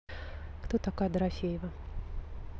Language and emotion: Russian, neutral